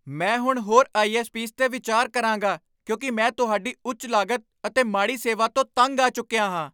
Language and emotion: Punjabi, angry